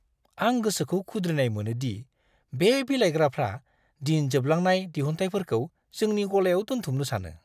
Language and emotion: Bodo, disgusted